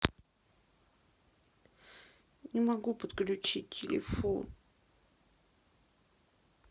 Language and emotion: Russian, sad